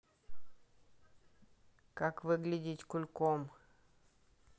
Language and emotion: Russian, neutral